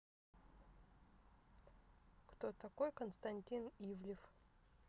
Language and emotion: Russian, neutral